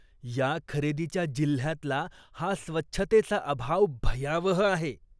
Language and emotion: Marathi, disgusted